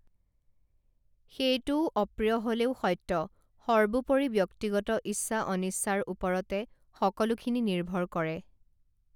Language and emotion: Assamese, neutral